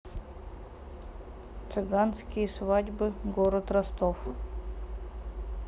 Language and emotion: Russian, neutral